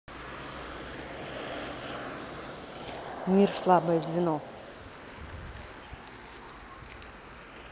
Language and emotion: Russian, neutral